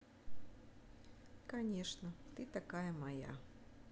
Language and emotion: Russian, neutral